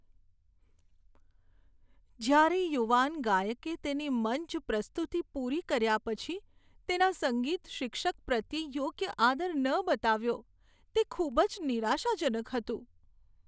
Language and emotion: Gujarati, sad